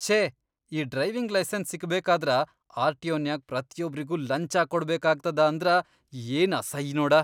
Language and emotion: Kannada, disgusted